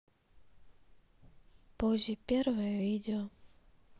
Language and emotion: Russian, neutral